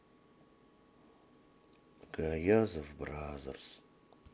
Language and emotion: Russian, sad